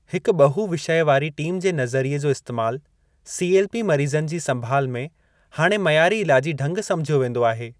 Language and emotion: Sindhi, neutral